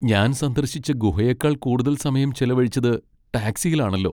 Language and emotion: Malayalam, sad